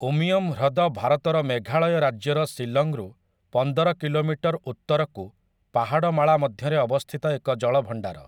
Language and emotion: Odia, neutral